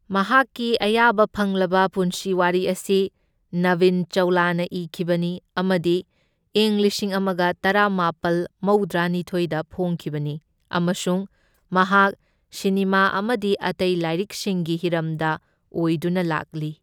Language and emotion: Manipuri, neutral